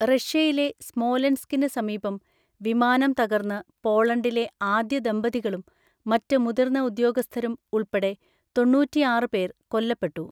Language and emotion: Malayalam, neutral